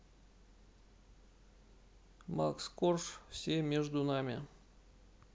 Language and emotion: Russian, neutral